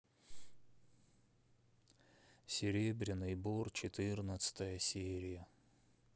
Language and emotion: Russian, sad